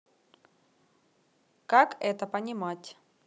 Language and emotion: Russian, neutral